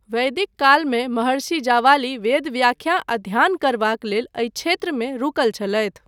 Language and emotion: Maithili, neutral